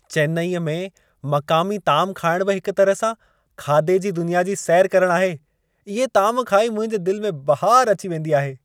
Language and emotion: Sindhi, happy